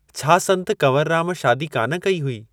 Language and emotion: Sindhi, neutral